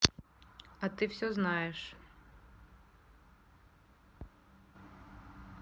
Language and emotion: Russian, neutral